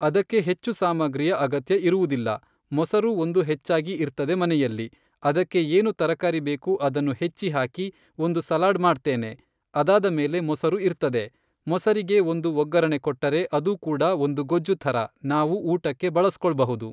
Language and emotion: Kannada, neutral